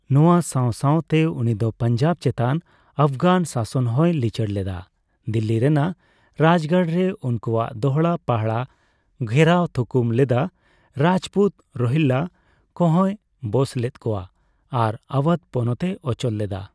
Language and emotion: Santali, neutral